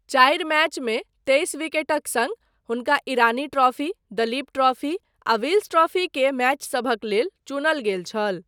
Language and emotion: Maithili, neutral